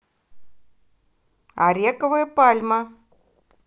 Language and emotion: Russian, positive